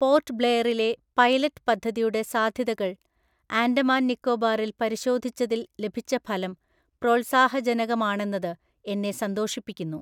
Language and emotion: Malayalam, neutral